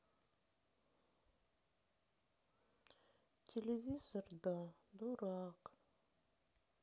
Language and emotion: Russian, sad